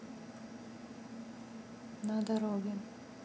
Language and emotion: Russian, neutral